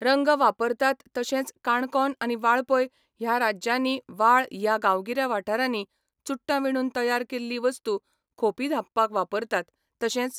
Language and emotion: Goan Konkani, neutral